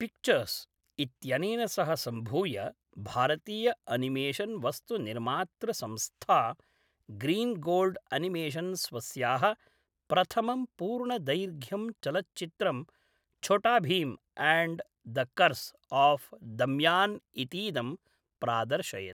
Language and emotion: Sanskrit, neutral